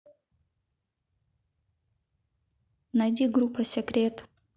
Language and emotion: Russian, neutral